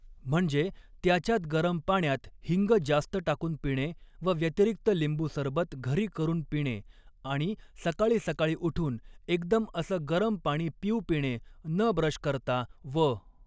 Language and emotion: Marathi, neutral